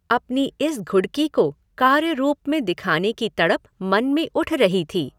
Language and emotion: Hindi, neutral